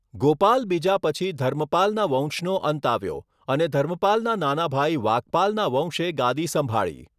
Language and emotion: Gujarati, neutral